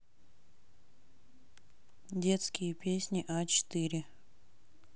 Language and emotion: Russian, neutral